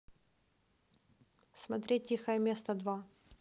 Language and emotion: Russian, neutral